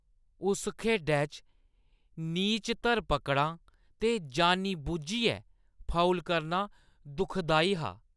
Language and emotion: Dogri, disgusted